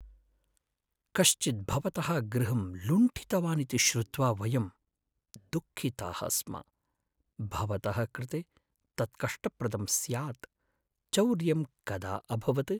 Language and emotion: Sanskrit, sad